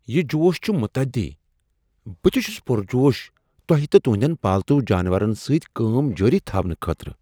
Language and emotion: Kashmiri, surprised